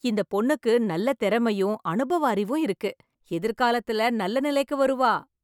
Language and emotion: Tamil, happy